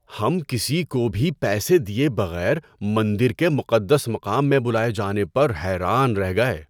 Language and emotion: Urdu, surprised